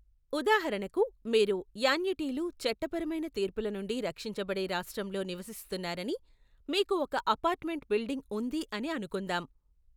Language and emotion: Telugu, neutral